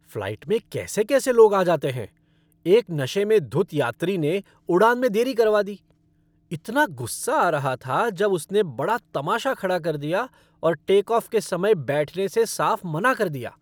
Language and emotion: Hindi, angry